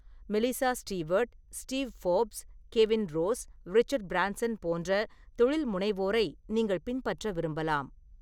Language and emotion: Tamil, neutral